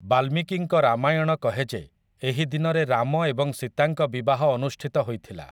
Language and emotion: Odia, neutral